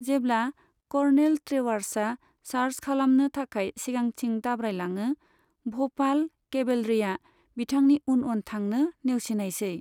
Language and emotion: Bodo, neutral